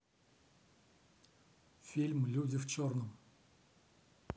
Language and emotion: Russian, neutral